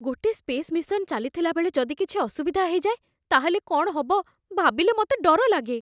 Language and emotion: Odia, fearful